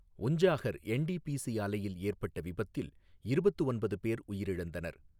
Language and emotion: Tamil, neutral